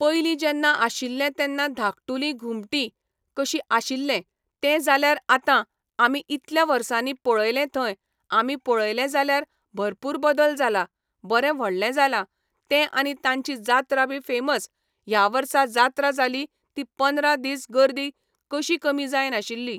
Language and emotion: Goan Konkani, neutral